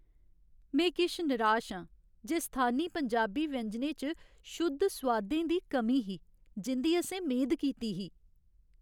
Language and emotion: Dogri, sad